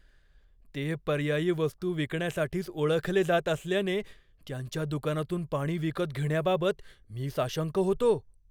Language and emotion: Marathi, fearful